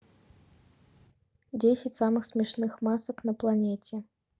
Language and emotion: Russian, neutral